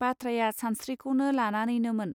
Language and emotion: Bodo, neutral